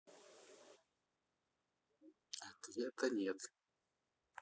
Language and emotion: Russian, neutral